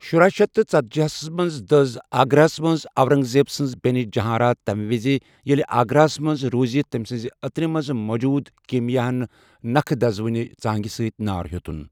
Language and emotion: Kashmiri, neutral